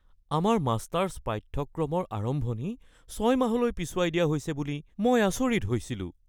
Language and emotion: Assamese, fearful